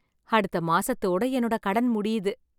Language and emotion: Tamil, happy